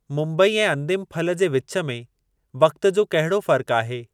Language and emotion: Sindhi, neutral